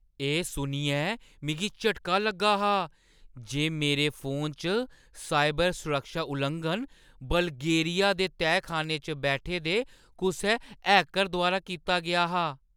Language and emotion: Dogri, surprised